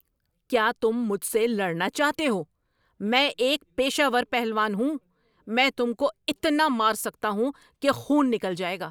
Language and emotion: Urdu, angry